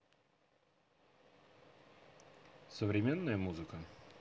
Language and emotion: Russian, neutral